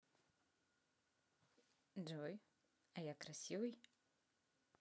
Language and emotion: Russian, positive